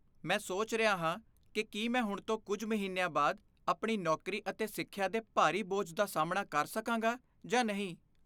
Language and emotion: Punjabi, fearful